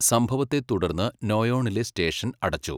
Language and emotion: Malayalam, neutral